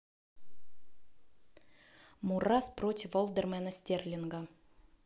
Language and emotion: Russian, neutral